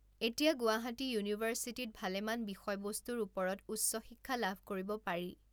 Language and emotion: Assamese, neutral